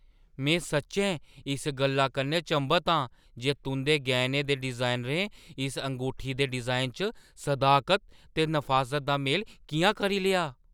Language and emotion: Dogri, surprised